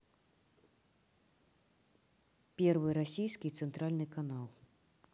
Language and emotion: Russian, neutral